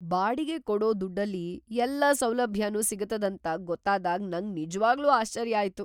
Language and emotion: Kannada, surprised